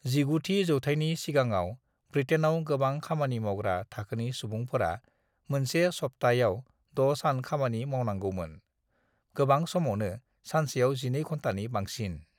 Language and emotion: Bodo, neutral